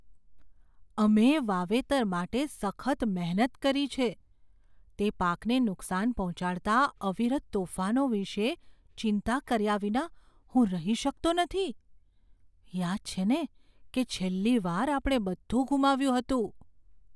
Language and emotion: Gujarati, fearful